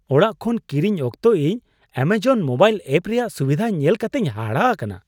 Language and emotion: Santali, surprised